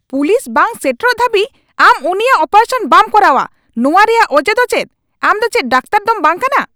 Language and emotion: Santali, angry